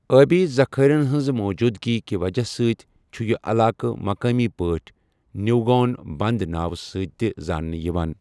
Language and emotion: Kashmiri, neutral